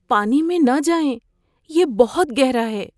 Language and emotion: Urdu, fearful